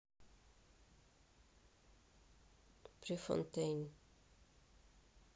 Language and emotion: Russian, neutral